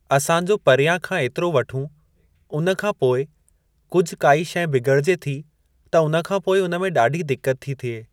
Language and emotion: Sindhi, neutral